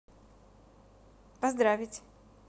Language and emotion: Russian, positive